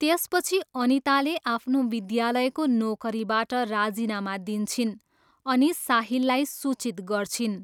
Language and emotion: Nepali, neutral